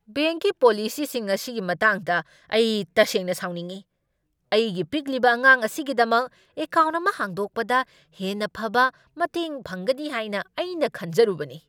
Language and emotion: Manipuri, angry